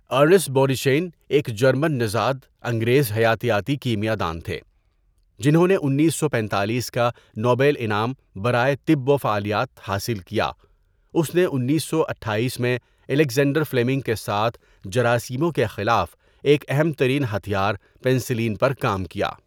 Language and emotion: Urdu, neutral